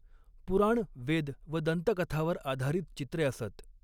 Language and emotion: Marathi, neutral